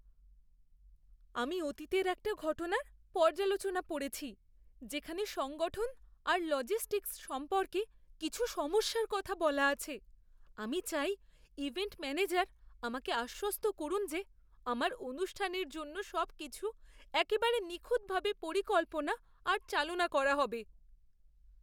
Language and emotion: Bengali, fearful